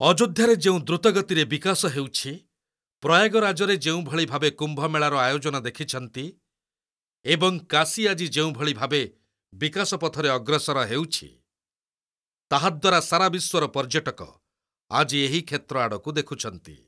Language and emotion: Odia, neutral